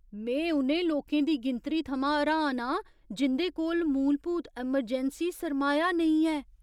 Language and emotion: Dogri, surprised